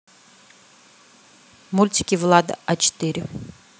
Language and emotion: Russian, neutral